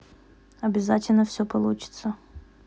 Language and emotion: Russian, neutral